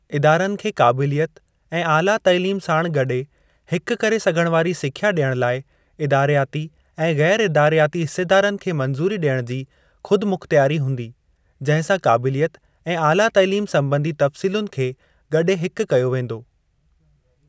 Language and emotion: Sindhi, neutral